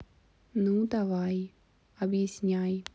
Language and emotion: Russian, neutral